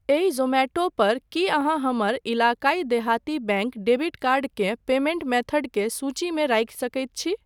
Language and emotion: Maithili, neutral